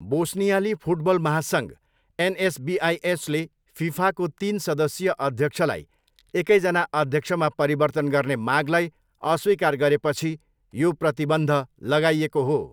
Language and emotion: Nepali, neutral